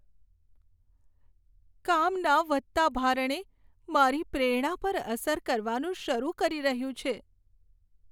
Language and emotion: Gujarati, sad